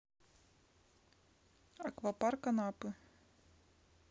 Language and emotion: Russian, neutral